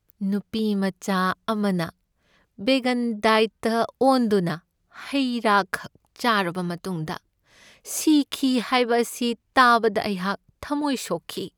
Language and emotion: Manipuri, sad